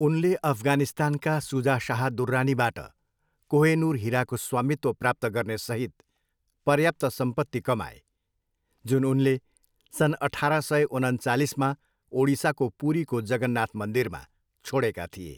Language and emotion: Nepali, neutral